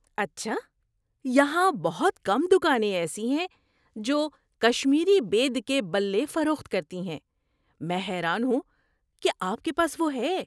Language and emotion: Urdu, surprised